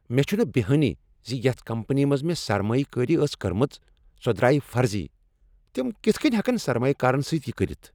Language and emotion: Kashmiri, angry